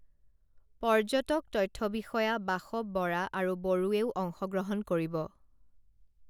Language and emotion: Assamese, neutral